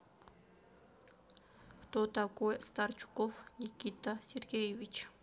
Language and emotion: Russian, neutral